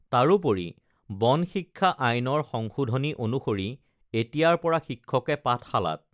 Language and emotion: Assamese, neutral